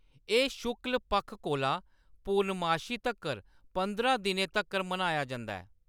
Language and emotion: Dogri, neutral